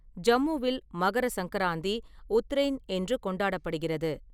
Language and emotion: Tamil, neutral